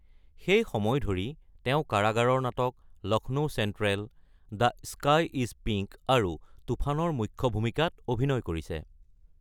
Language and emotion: Assamese, neutral